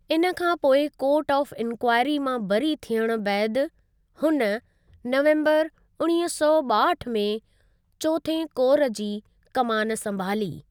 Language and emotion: Sindhi, neutral